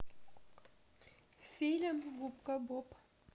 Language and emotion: Russian, neutral